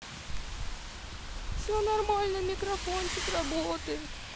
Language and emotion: Russian, sad